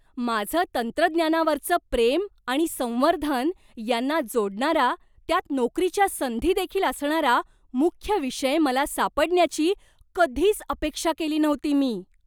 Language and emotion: Marathi, surprised